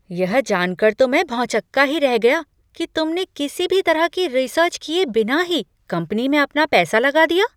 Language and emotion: Hindi, surprised